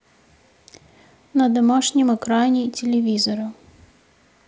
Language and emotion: Russian, neutral